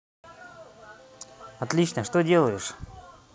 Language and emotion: Russian, positive